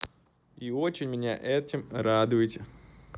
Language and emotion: Russian, positive